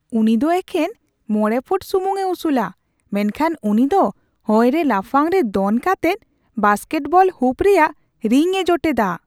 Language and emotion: Santali, surprised